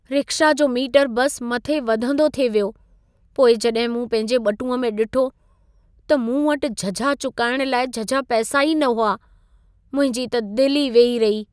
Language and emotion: Sindhi, sad